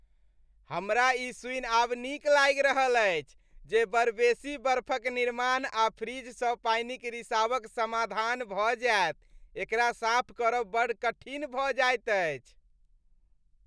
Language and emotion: Maithili, happy